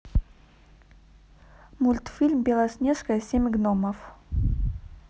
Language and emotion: Russian, neutral